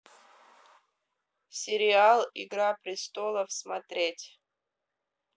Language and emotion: Russian, neutral